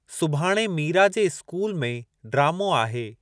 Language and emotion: Sindhi, neutral